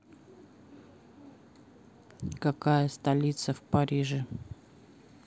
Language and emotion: Russian, neutral